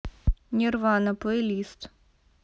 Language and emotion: Russian, neutral